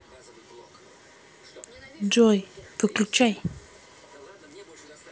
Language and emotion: Russian, neutral